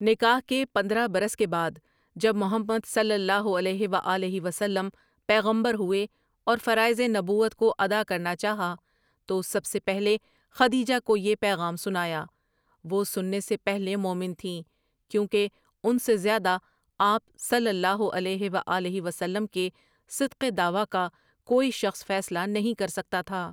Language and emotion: Urdu, neutral